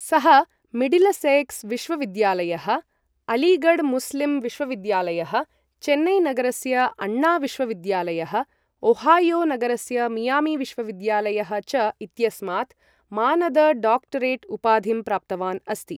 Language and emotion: Sanskrit, neutral